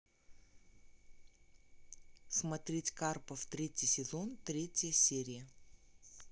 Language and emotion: Russian, neutral